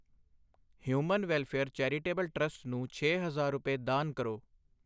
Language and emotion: Punjabi, neutral